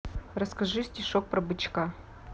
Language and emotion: Russian, neutral